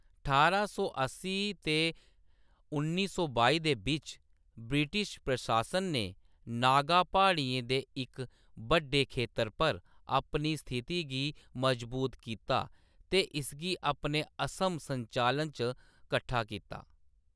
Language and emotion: Dogri, neutral